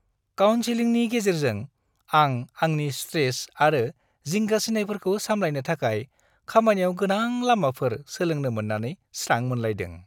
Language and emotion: Bodo, happy